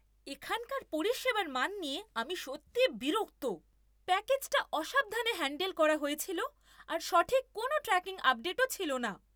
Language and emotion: Bengali, angry